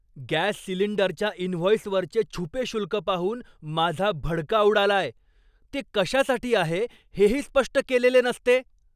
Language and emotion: Marathi, angry